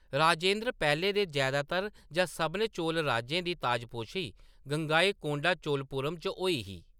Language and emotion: Dogri, neutral